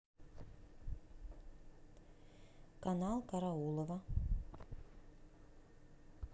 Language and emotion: Russian, neutral